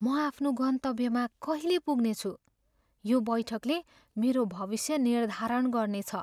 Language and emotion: Nepali, fearful